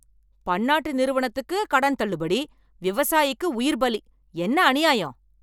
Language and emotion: Tamil, angry